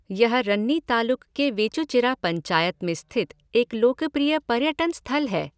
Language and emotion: Hindi, neutral